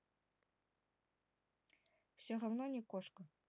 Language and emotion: Russian, neutral